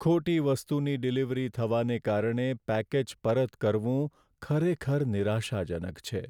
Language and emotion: Gujarati, sad